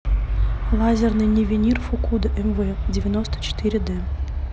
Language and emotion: Russian, neutral